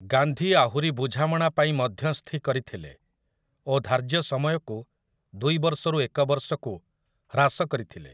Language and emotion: Odia, neutral